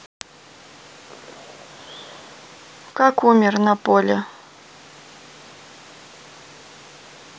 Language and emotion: Russian, neutral